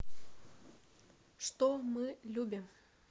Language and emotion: Russian, neutral